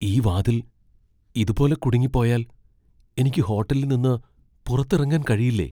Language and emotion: Malayalam, fearful